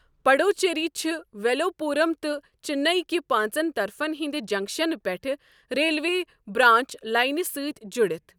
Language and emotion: Kashmiri, neutral